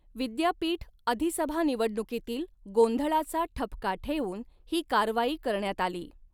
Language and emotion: Marathi, neutral